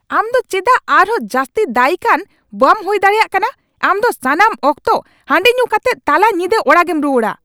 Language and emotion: Santali, angry